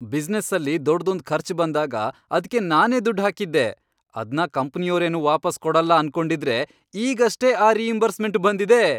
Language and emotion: Kannada, happy